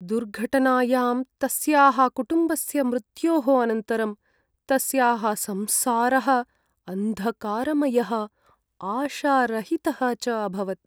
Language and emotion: Sanskrit, sad